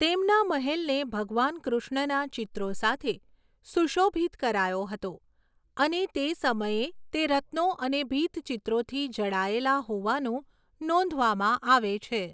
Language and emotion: Gujarati, neutral